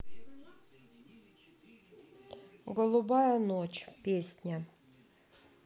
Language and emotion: Russian, neutral